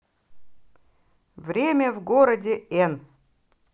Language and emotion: Russian, positive